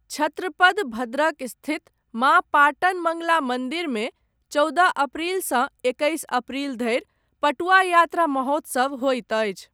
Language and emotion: Maithili, neutral